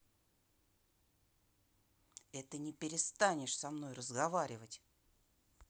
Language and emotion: Russian, angry